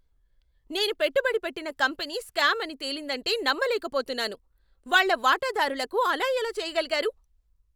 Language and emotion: Telugu, angry